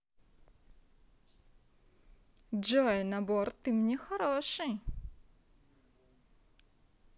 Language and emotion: Russian, positive